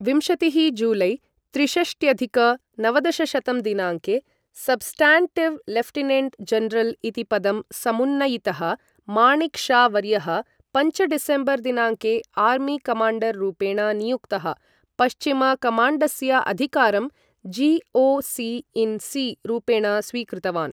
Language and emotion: Sanskrit, neutral